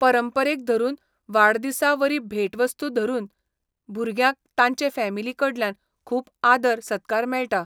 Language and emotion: Goan Konkani, neutral